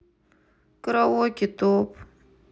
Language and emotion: Russian, sad